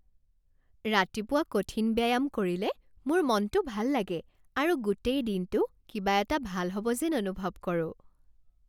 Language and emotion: Assamese, happy